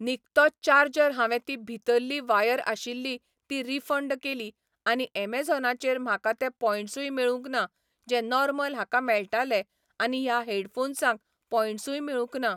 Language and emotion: Goan Konkani, neutral